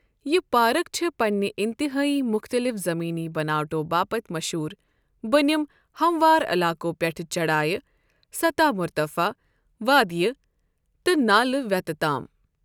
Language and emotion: Kashmiri, neutral